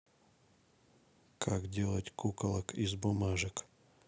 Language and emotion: Russian, neutral